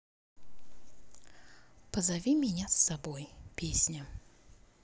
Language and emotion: Russian, neutral